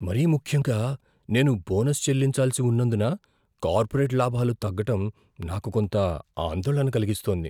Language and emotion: Telugu, fearful